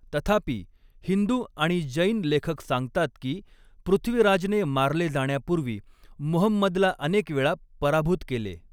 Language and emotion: Marathi, neutral